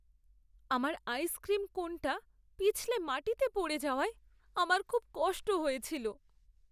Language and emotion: Bengali, sad